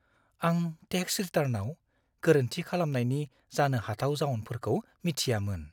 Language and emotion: Bodo, fearful